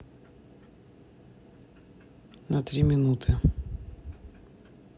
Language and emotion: Russian, neutral